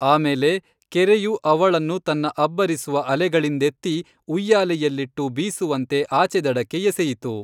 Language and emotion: Kannada, neutral